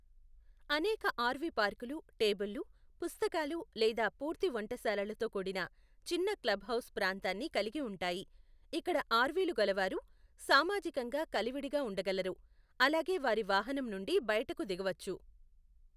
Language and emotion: Telugu, neutral